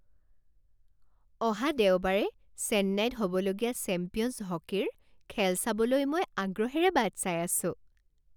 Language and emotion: Assamese, happy